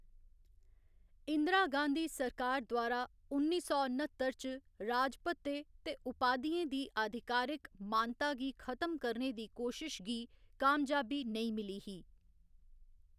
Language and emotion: Dogri, neutral